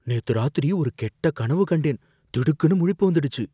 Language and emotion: Tamil, fearful